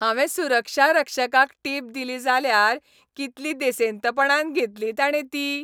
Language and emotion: Goan Konkani, happy